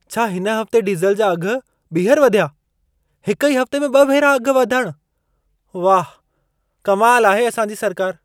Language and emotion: Sindhi, surprised